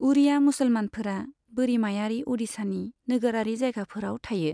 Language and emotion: Bodo, neutral